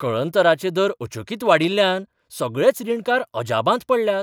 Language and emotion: Goan Konkani, surprised